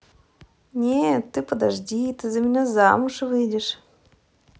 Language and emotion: Russian, positive